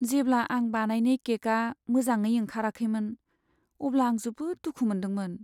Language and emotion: Bodo, sad